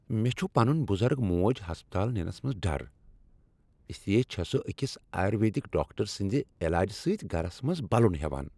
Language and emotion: Kashmiri, happy